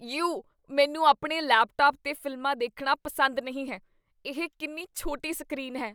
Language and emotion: Punjabi, disgusted